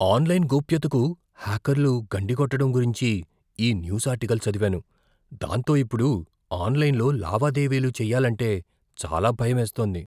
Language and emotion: Telugu, fearful